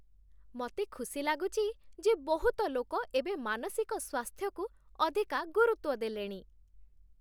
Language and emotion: Odia, happy